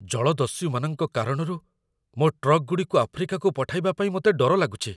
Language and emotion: Odia, fearful